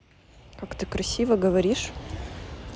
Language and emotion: Russian, neutral